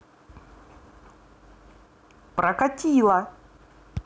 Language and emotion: Russian, positive